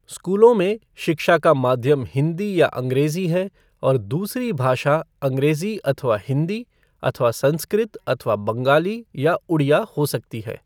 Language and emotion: Hindi, neutral